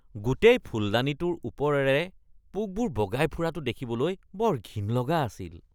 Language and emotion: Assamese, disgusted